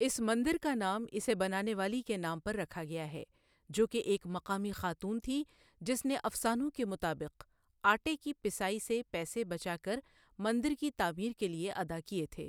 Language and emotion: Urdu, neutral